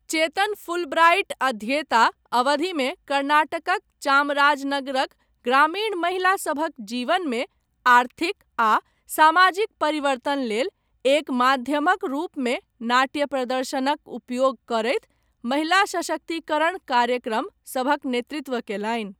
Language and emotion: Maithili, neutral